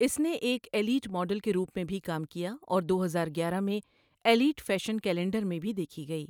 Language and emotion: Urdu, neutral